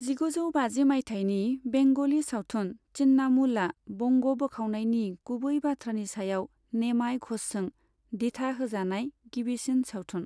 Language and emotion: Bodo, neutral